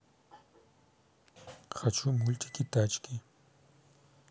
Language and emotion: Russian, neutral